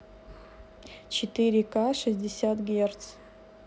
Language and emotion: Russian, neutral